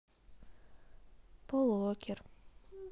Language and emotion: Russian, neutral